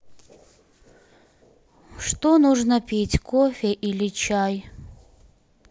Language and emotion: Russian, sad